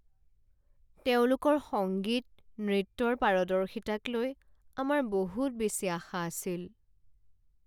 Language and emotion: Assamese, sad